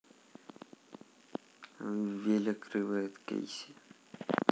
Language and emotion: Russian, neutral